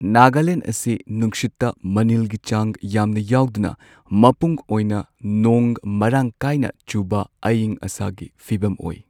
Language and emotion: Manipuri, neutral